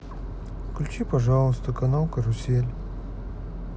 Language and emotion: Russian, sad